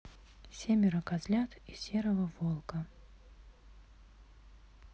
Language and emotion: Russian, neutral